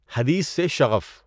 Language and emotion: Urdu, neutral